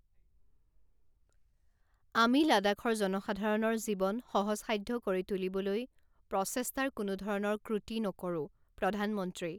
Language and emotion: Assamese, neutral